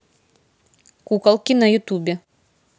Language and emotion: Russian, neutral